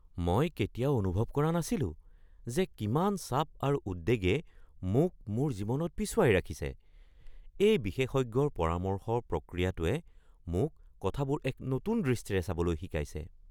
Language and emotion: Assamese, surprised